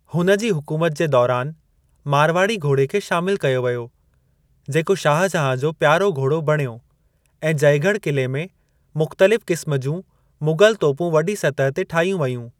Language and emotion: Sindhi, neutral